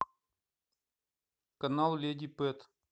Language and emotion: Russian, neutral